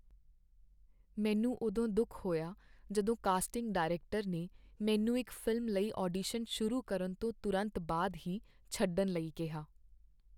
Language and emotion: Punjabi, sad